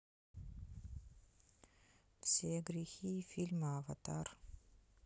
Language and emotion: Russian, neutral